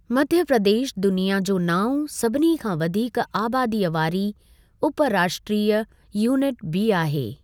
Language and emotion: Sindhi, neutral